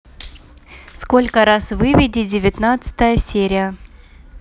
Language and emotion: Russian, neutral